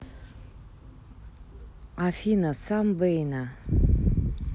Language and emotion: Russian, neutral